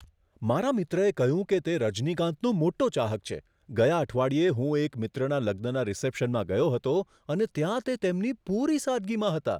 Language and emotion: Gujarati, surprised